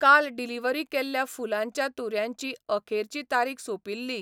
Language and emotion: Goan Konkani, neutral